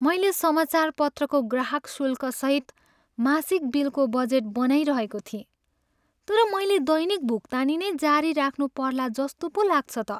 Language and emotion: Nepali, sad